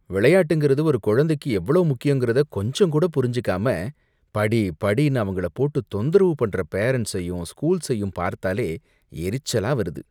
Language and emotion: Tamil, disgusted